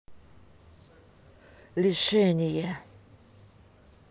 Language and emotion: Russian, angry